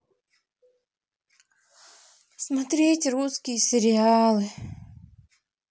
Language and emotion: Russian, sad